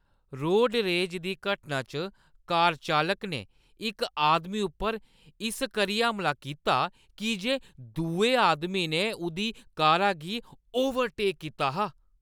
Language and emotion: Dogri, angry